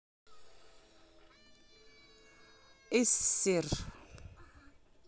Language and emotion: Russian, neutral